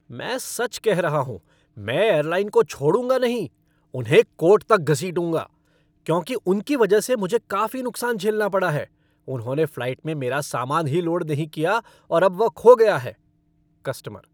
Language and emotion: Hindi, angry